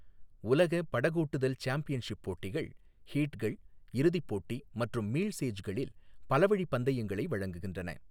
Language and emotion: Tamil, neutral